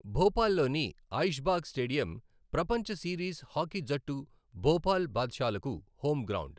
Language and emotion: Telugu, neutral